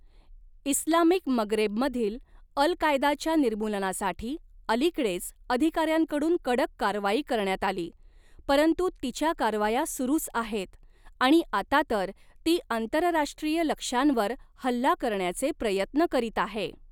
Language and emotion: Marathi, neutral